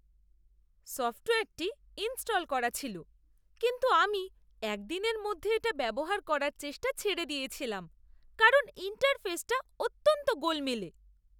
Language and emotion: Bengali, disgusted